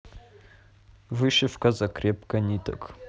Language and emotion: Russian, neutral